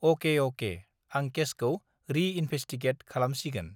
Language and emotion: Bodo, neutral